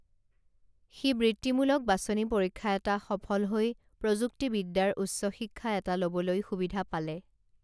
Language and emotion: Assamese, neutral